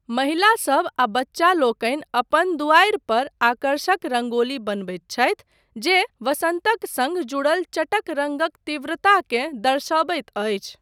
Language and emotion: Maithili, neutral